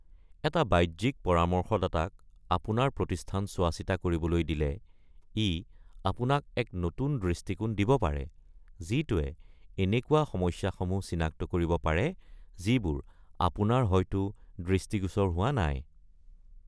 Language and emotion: Assamese, neutral